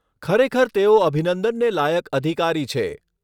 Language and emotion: Gujarati, neutral